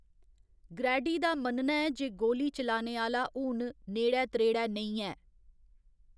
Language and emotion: Dogri, neutral